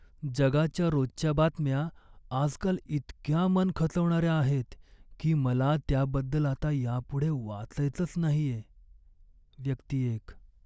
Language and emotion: Marathi, sad